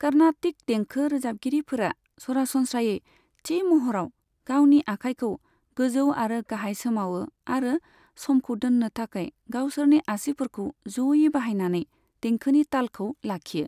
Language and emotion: Bodo, neutral